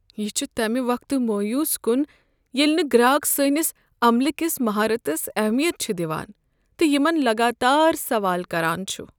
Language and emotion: Kashmiri, sad